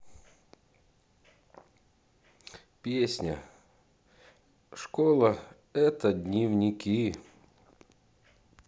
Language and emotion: Russian, neutral